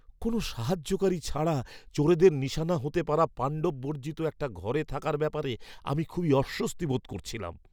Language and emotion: Bengali, fearful